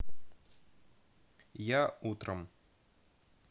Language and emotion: Russian, neutral